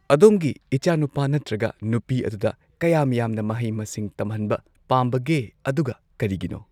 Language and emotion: Manipuri, neutral